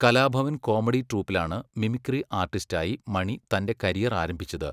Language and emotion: Malayalam, neutral